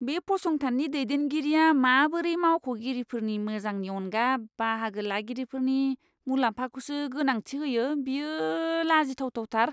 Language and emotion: Bodo, disgusted